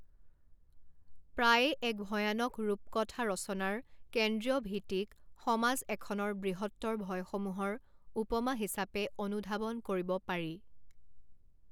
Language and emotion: Assamese, neutral